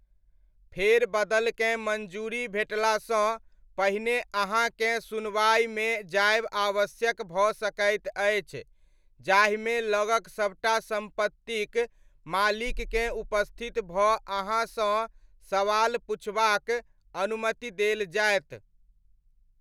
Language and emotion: Maithili, neutral